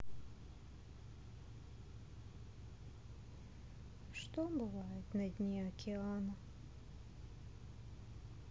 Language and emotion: Russian, sad